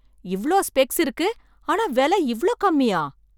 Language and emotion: Tamil, surprised